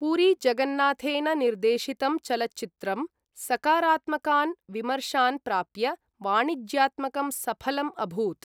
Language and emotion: Sanskrit, neutral